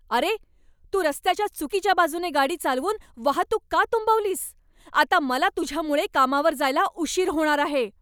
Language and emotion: Marathi, angry